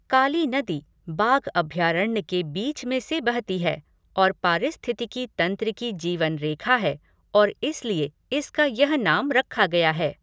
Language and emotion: Hindi, neutral